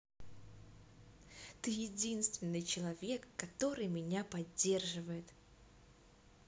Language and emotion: Russian, positive